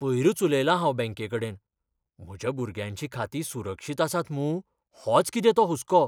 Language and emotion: Goan Konkani, fearful